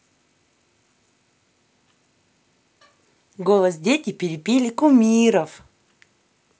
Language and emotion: Russian, positive